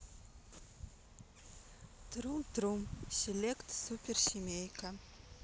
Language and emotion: Russian, neutral